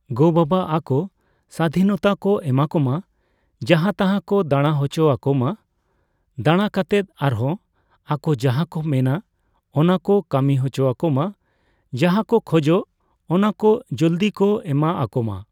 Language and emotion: Santali, neutral